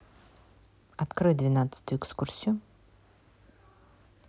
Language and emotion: Russian, neutral